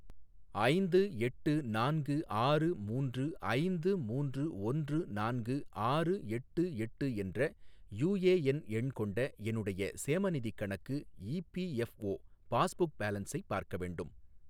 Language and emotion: Tamil, neutral